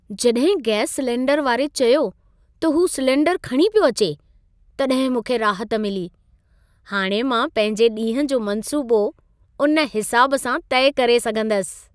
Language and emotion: Sindhi, happy